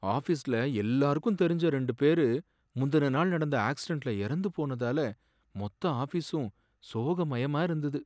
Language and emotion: Tamil, sad